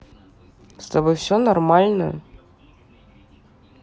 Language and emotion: Russian, neutral